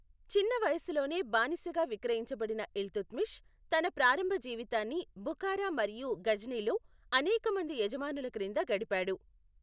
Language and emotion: Telugu, neutral